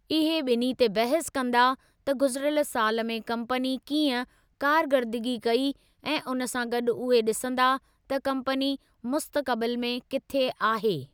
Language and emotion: Sindhi, neutral